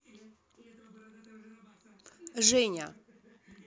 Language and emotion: Russian, neutral